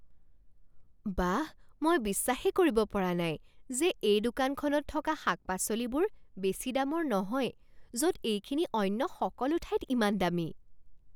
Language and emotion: Assamese, surprised